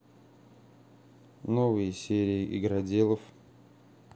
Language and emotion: Russian, neutral